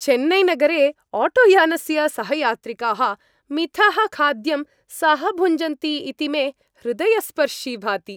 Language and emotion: Sanskrit, happy